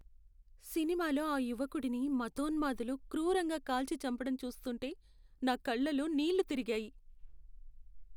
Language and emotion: Telugu, sad